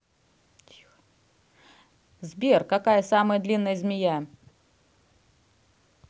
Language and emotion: Russian, neutral